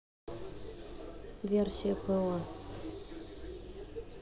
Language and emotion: Russian, neutral